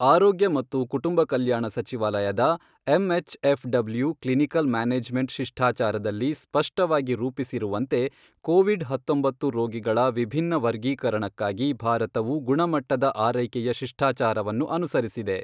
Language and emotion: Kannada, neutral